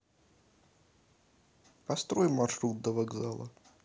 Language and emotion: Russian, neutral